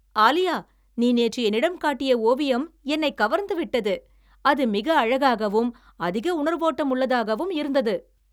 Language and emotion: Tamil, happy